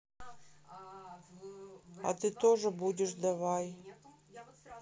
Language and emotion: Russian, sad